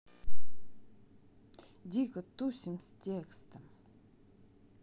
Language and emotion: Russian, neutral